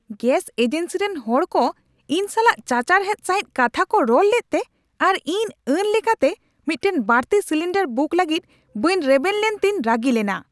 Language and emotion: Santali, angry